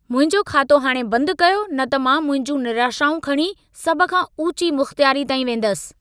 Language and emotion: Sindhi, angry